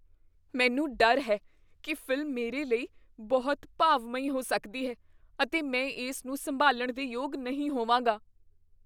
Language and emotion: Punjabi, fearful